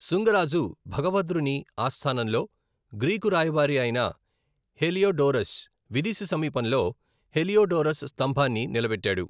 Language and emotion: Telugu, neutral